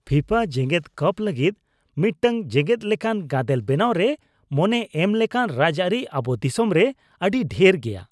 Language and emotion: Santali, disgusted